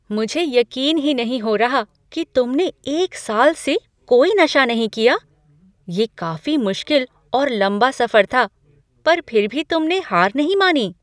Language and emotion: Hindi, surprised